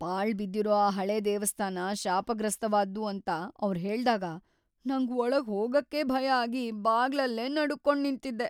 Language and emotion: Kannada, fearful